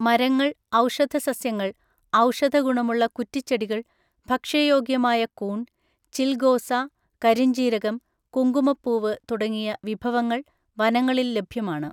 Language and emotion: Malayalam, neutral